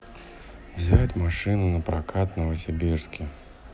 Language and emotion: Russian, neutral